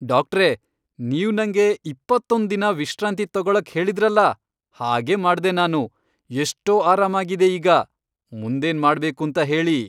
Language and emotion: Kannada, happy